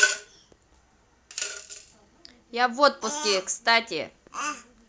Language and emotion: Russian, positive